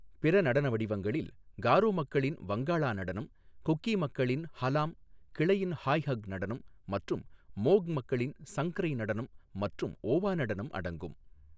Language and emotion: Tamil, neutral